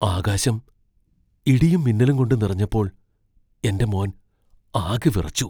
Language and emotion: Malayalam, fearful